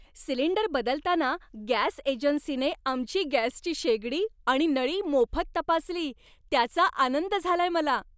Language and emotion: Marathi, happy